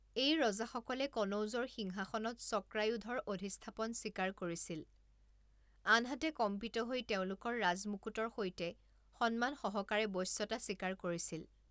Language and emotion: Assamese, neutral